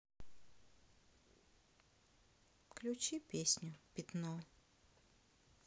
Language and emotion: Russian, sad